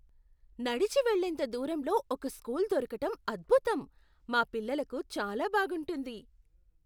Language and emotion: Telugu, surprised